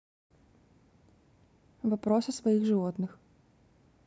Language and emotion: Russian, neutral